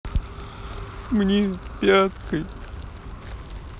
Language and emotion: Russian, sad